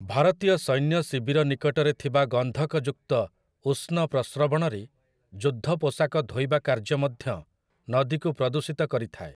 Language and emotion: Odia, neutral